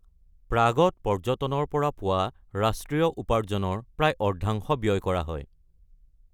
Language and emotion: Assamese, neutral